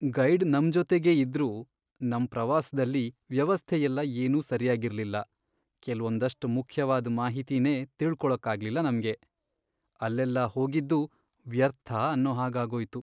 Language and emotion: Kannada, sad